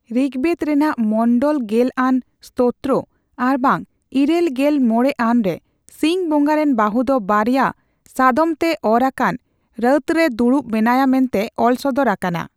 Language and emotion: Santali, neutral